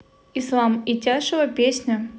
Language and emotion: Russian, neutral